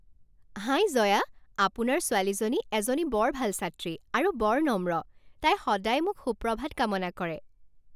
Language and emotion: Assamese, happy